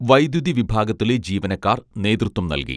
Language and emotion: Malayalam, neutral